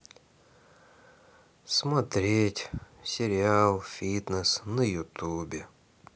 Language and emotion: Russian, sad